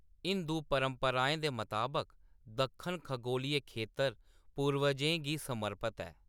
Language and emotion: Dogri, neutral